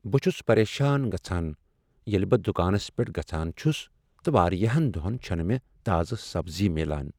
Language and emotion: Kashmiri, sad